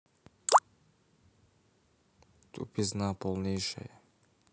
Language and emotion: Russian, neutral